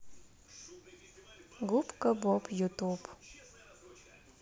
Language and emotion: Russian, neutral